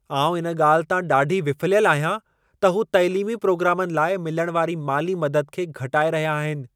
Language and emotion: Sindhi, angry